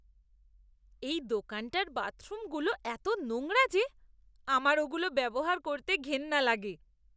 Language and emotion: Bengali, disgusted